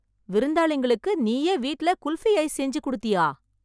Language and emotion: Tamil, surprised